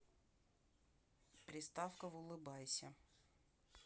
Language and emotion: Russian, neutral